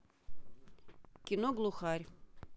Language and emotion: Russian, neutral